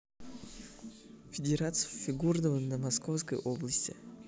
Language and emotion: Russian, neutral